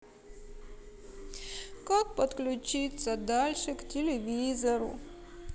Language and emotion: Russian, sad